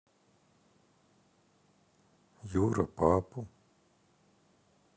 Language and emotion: Russian, sad